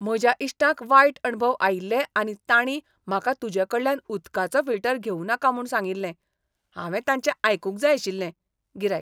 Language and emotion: Goan Konkani, disgusted